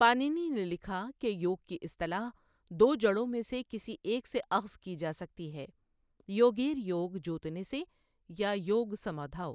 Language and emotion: Urdu, neutral